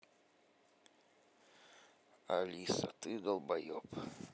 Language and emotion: Russian, neutral